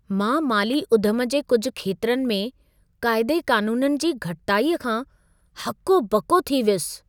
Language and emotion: Sindhi, surprised